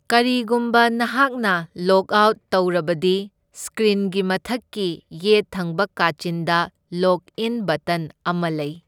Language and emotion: Manipuri, neutral